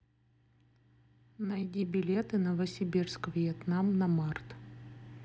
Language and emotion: Russian, neutral